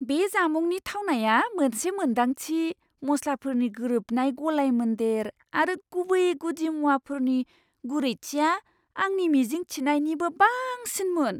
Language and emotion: Bodo, surprised